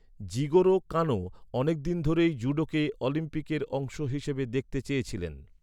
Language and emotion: Bengali, neutral